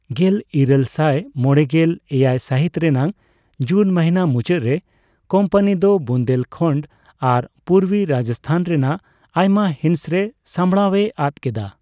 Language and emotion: Santali, neutral